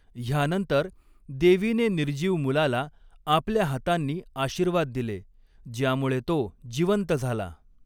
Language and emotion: Marathi, neutral